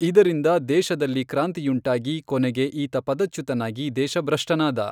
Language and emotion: Kannada, neutral